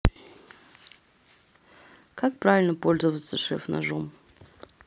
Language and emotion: Russian, neutral